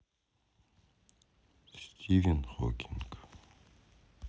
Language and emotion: Russian, sad